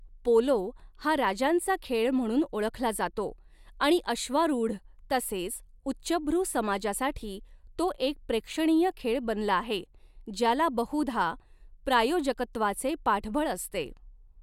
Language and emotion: Marathi, neutral